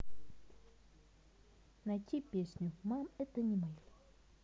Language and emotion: Russian, neutral